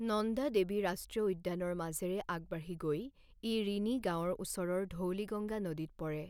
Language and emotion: Assamese, neutral